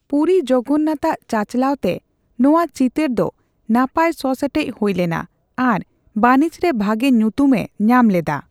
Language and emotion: Santali, neutral